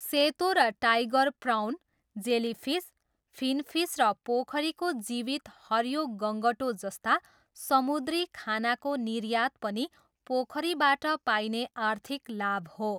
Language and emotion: Nepali, neutral